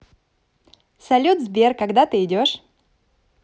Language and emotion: Russian, positive